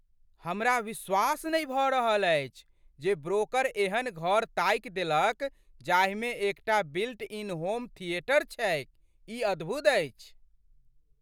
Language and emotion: Maithili, surprised